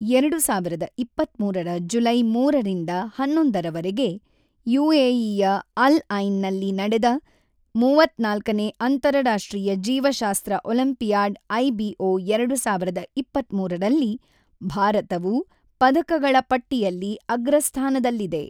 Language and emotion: Kannada, neutral